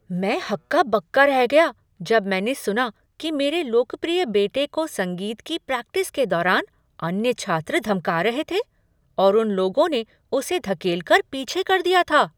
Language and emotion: Hindi, surprised